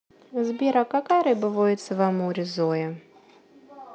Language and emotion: Russian, neutral